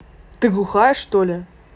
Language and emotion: Russian, angry